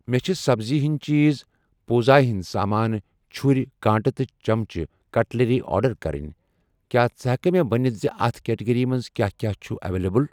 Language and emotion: Kashmiri, neutral